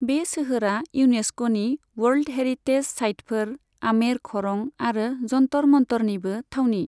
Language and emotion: Bodo, neutral